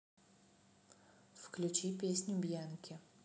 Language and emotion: Russian, neutral